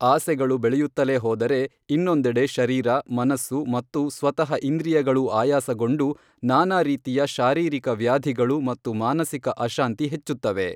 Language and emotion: Kannada, neutral